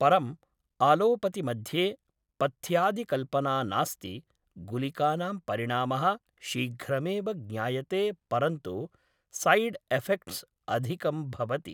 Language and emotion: Sanskrit, neutral